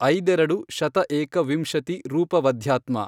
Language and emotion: Kannada, neutral